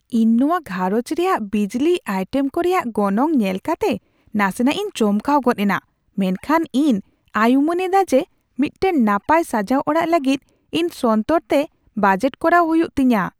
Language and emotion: Santali, surprised